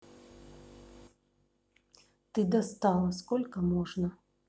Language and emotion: Russian, angry